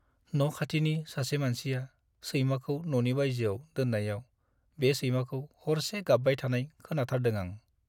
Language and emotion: Bodo, sad